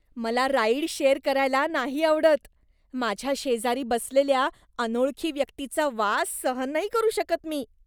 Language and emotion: Marathi, disgusted